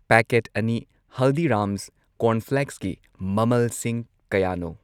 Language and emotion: Manipuri, neutral